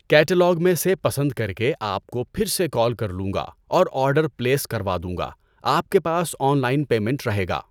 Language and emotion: Urdu, neutral